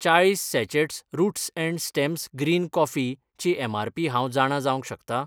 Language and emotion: Goan Konkani, neutral